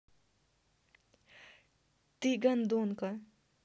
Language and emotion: Russian, angry